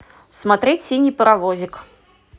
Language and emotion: Russian, positive